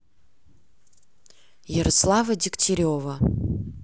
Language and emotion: Russian, neutral